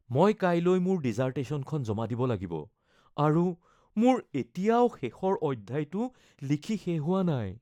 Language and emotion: Assamese, fearful